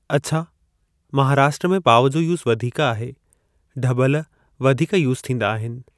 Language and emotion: Sindhi, neutral